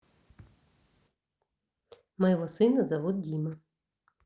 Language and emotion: Russian, neutral